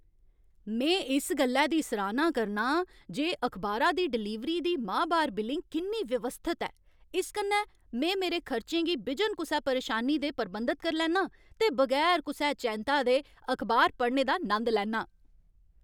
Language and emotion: Dogri, happy